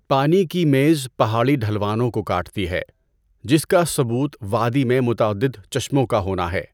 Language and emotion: Urdu, neutral